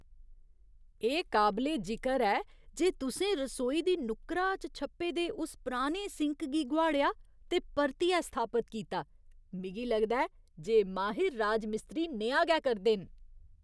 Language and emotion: Dogri, surprised